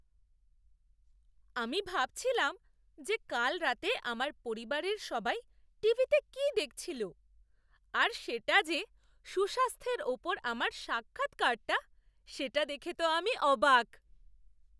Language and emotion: Bengali, surprised